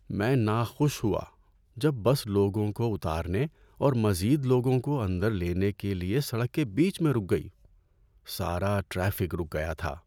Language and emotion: Urdu, sad